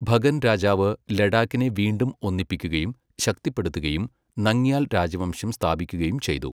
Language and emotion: Malayalam, neutral